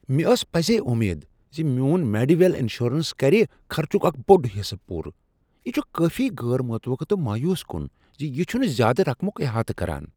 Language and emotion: Kashmiri, surprised